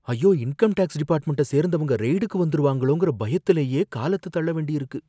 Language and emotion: Tamil, fearful